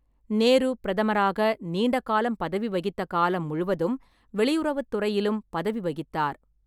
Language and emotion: Tamil, neutral